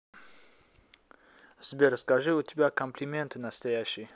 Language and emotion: Russian, neutral